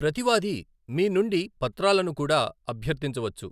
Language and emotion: Telugu, neutral